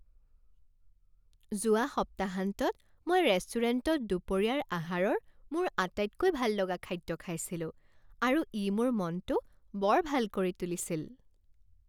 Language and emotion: Assamese, happy